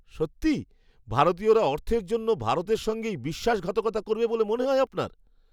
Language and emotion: Bengali, surprised